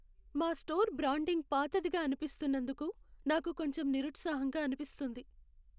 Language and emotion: Telugu, sad